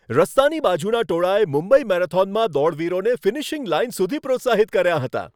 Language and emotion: Gujarati, happy